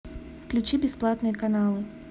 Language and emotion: Russian, neutral